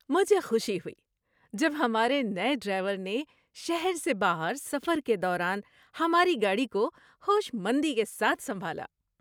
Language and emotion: Urdu, happy